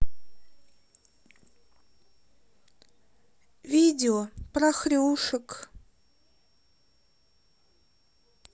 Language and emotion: Russian, sad